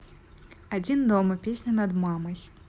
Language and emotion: Russian, neutral